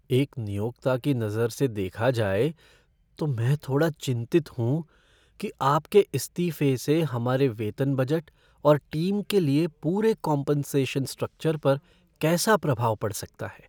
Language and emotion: Hindi, fearful